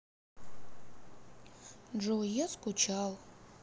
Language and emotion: Russian, sad